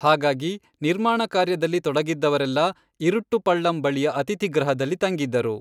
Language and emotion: Kannada, neutral